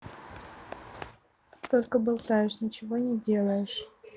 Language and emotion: Russian, neutral